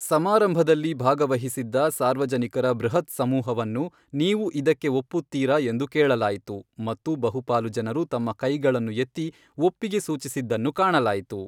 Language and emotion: Kannada, neutral